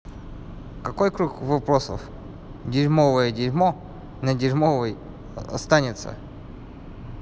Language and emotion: Russian, neutral